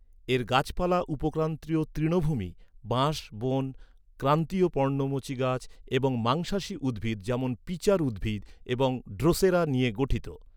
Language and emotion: Bengali, neutral